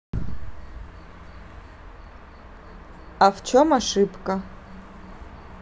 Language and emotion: Russian, neutral